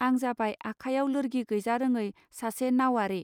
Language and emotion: Bodo, neutral